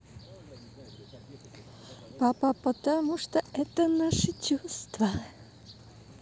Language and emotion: Russian, positive